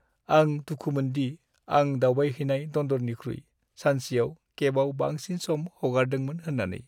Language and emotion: Bodo, sad